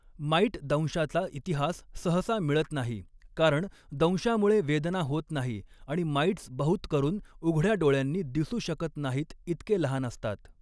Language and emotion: Marathi, neutral